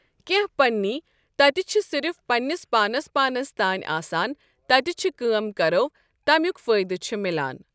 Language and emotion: Kashmiri, neutral